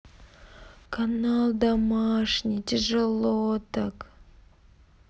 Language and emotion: Russian, sad